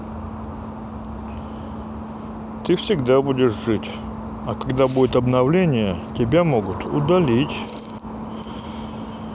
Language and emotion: Russian, neutral